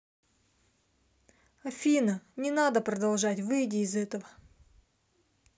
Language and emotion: Russian, neutral